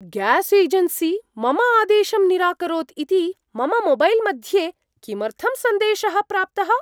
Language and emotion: Sanskrit, surprised